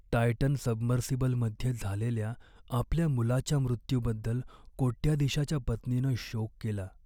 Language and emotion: Marathi, sad